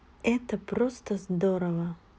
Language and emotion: Russian, positive